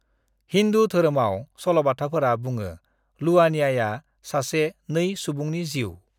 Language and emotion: Bodo, neutral